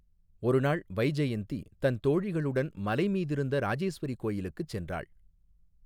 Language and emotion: Tamil, neutral